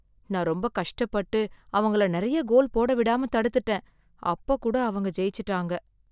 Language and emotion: Tamil, sad